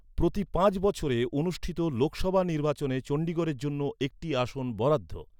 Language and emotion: Bengali, neutral